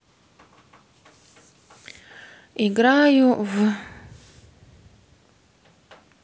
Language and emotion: Russian, neutral